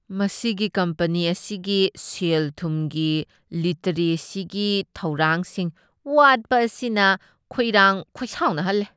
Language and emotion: Manipuri, disgusted